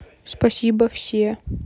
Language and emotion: Russian, neutral